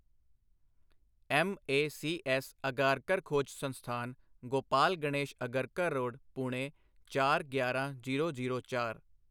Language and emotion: Punjabi, neutral